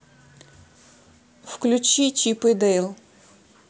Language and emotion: Russian, neutral